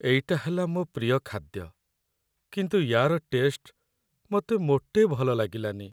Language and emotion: Odia, sad